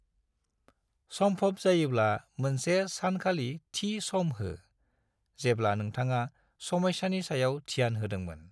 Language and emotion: Bodo, neutral